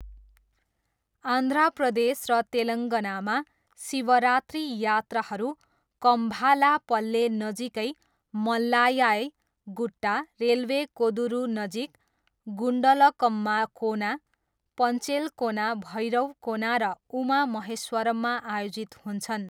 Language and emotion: Nepali, neutral